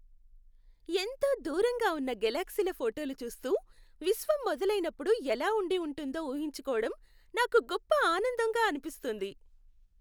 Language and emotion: Telugu, happy